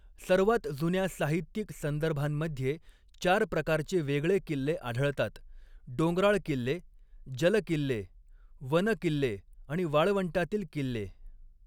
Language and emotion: Marathi, neutral